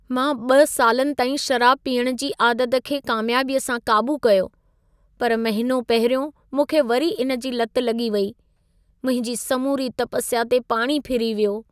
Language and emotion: Sindhi, sad